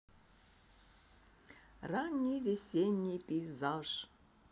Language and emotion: Russian, positive